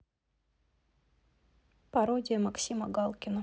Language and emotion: Russian, neutral